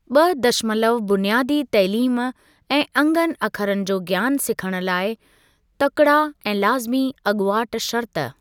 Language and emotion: Sindhi, neutral